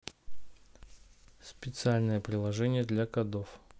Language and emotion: Russian, neutral